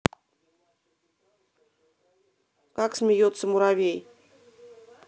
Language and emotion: Russian, neutral